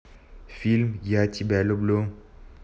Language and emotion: Russian, neutral